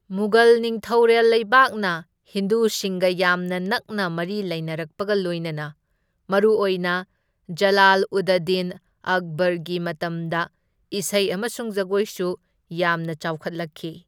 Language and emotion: Manipuri, neutral